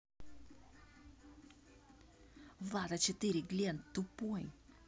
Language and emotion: Russian, angry